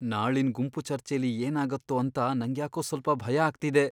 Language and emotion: Kannada, fearful